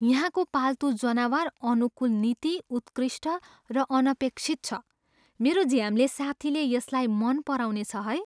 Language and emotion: Nepali, surprised